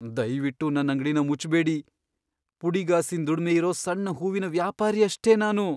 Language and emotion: Kannada, fearful